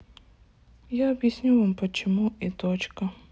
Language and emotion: Russian, sad